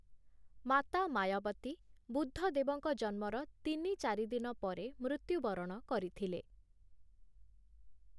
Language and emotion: Odia, neutral